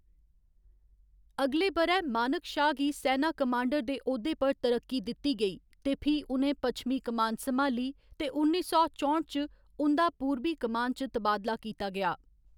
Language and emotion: Dogri, neutral